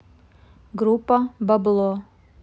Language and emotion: Russian, neutral